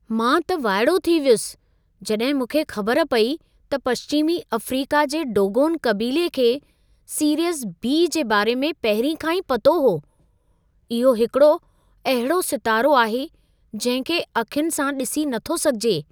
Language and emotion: Sindhi, surprised